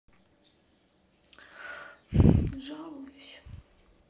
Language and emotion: Russian, sad